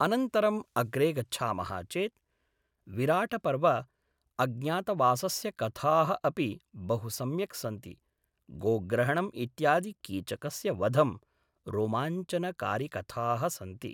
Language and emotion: Sanskrit, neutral